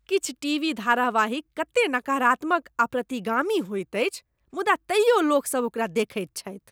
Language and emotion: Maithili, disgusted